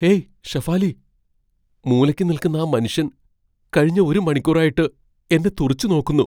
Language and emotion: Malayalam, fearful